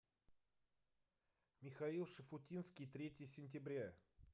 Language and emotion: Russian, neutral